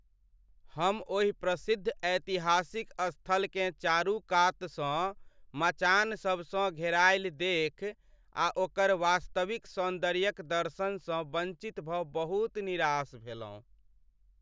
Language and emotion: Maithili, sad